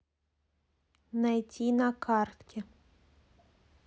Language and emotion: Russian, neutral